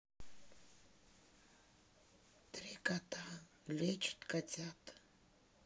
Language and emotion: Russian, neutral